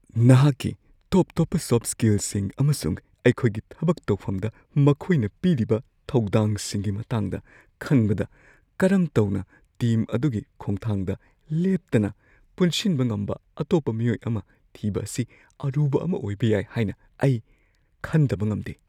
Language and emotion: Manipuri, fearful